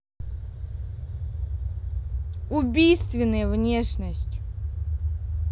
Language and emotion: Russian, neutral